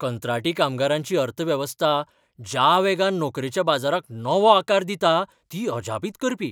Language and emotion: Goan Konkani, surprised